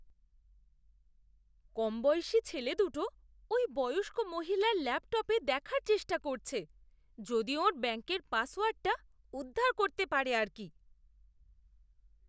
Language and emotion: Bengali, disgusted